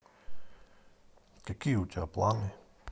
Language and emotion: Russian, neutral